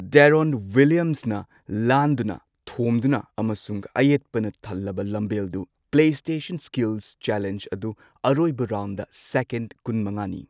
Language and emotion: Manipuri, neutral